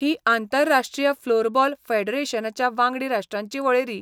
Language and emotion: Goan Konkani, neutral